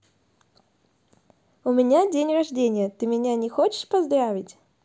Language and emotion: Russian, positive